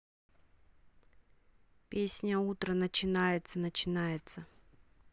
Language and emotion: Russian, neutral